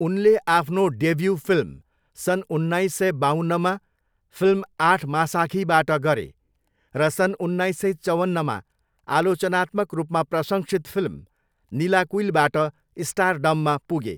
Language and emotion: Nepali, neutral